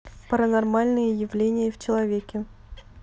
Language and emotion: Russian, neutral